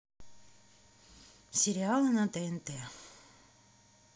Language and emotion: Russian, neutral